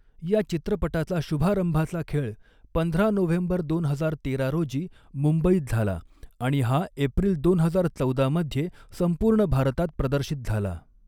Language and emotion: Marathi, neutral